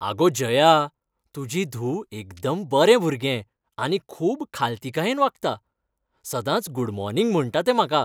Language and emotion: Goan Konkani, happy